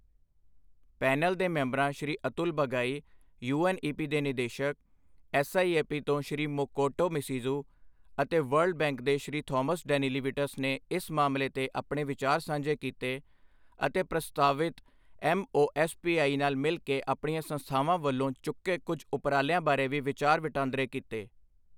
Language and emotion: Punjabi, neutral